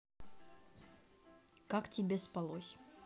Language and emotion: Russian, neutral